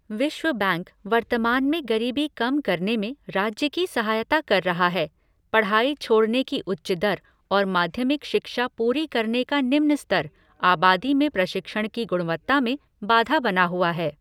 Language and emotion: Hindi, neutral